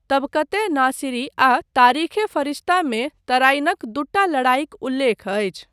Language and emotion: Maithili, neutral